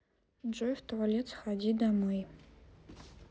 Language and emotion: Russian, neutral